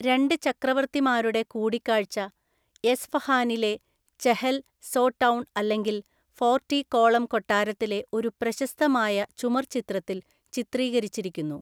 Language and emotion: Malayalam, neutral